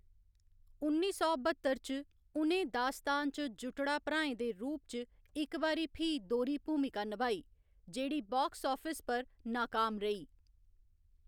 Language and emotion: Dogri, neutral